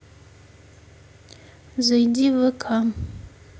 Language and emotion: Russian, neutral